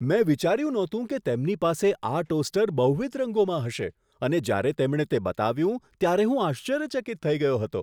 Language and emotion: Gujarati, surprised